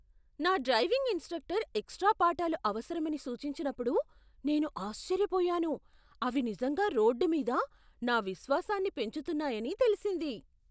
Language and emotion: Telugu, surprised